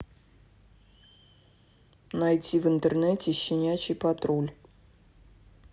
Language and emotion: Russian, neutral